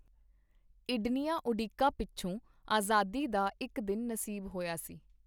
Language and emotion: Punjabi, neutral